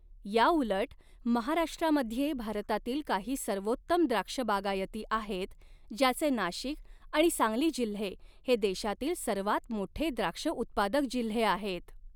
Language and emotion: Marathi, neutral